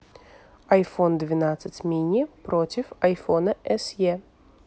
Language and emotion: Russian, neutral